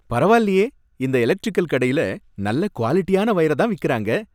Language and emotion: Tamil, happy